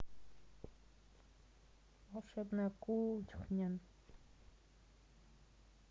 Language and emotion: Russian, neutral